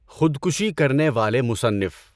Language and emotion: Urdu, neutral